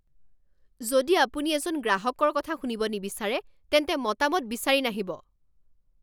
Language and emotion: Assamese, angry